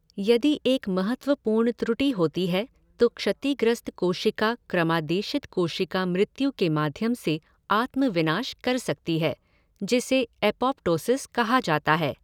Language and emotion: Hindi, neutral